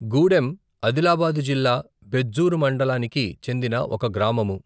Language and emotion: Telugu, neutral